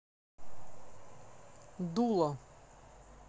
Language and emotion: Russian, neutral